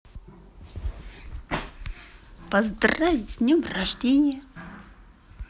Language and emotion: Russian, positive